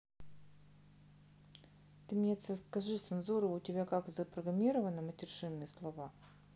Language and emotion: Russian, neutral